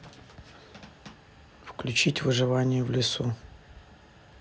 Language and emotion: Russian, neutral